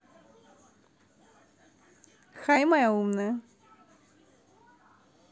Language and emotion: Russian, positive